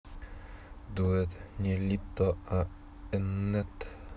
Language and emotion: Russian, neutral